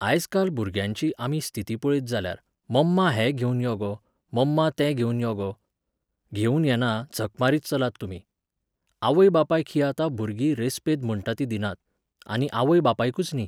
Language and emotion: Goan Konkani, neutral